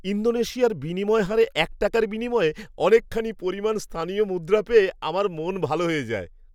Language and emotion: Bengali, happy